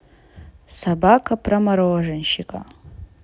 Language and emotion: Russian, neutral